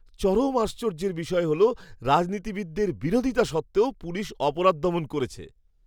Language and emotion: Bengali, surprised